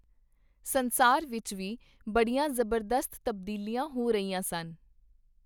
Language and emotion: Punjabi, neutral